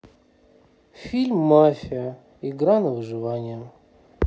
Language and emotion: Russian, sad